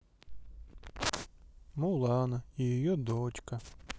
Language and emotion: Russian, sad